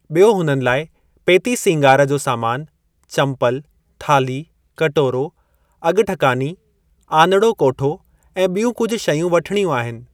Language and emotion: Sindhi, neutral